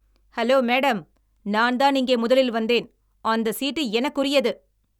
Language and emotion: Tamil, angry